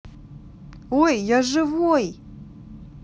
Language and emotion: Russian, positive